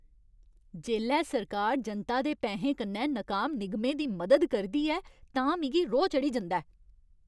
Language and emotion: Dogri, angry